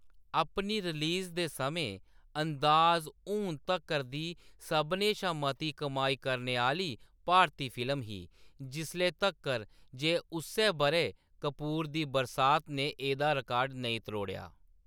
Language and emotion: Dogri, neutral